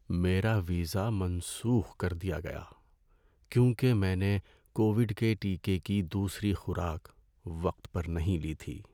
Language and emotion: Urdu, sad